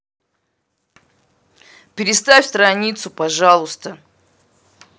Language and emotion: Russian, angry